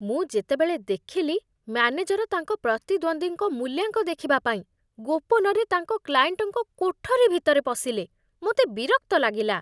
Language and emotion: Odia, disgusted